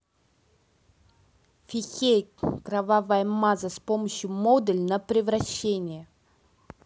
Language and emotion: Russian, angry